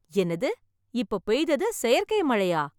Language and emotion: Tamil, surprised